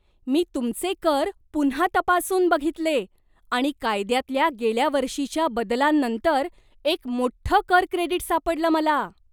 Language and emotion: Marathi, surprised